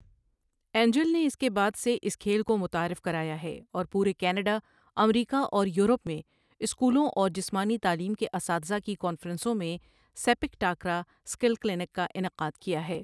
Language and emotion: Urdu, neutral